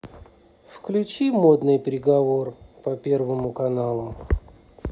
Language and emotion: Russian, neutral